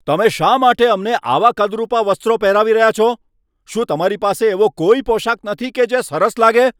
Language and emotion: Gujarati, angry